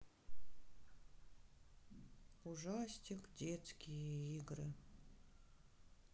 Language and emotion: Russian, sad